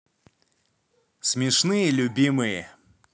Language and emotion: Russian, positive